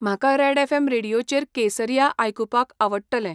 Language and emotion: Goan Konkani, neutral